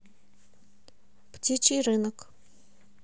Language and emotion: Russian, neutral